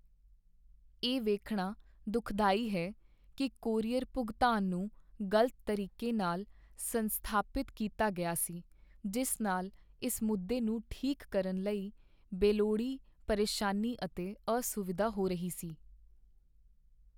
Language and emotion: Punjabi, sad